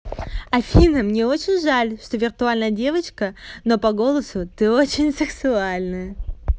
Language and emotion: Russian, positive